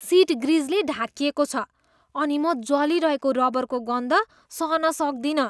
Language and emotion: Nepali, disgusted